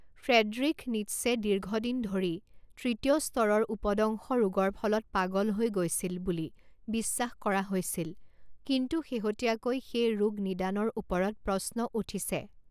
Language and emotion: Assamese, neutral